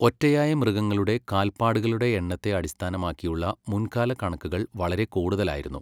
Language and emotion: Malayalam, neutral